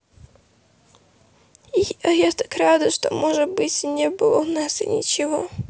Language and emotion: Russian, sad